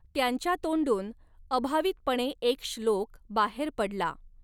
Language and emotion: Marathi, neutral